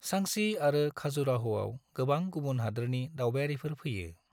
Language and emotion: Bodo, neutral